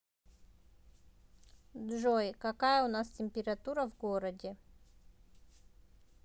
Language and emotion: Russian, neutral